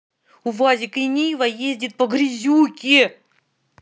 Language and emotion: Russian, angry